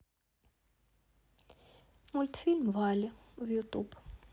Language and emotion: Russian, neutral